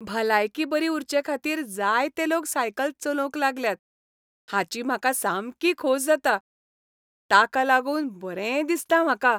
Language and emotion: Goan Konkani, happy